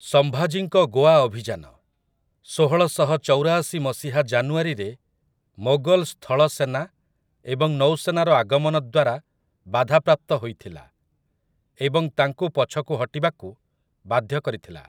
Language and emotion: Odia, neutral